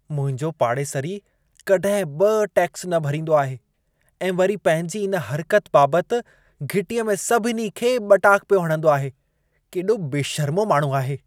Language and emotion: Sindhi, disgusted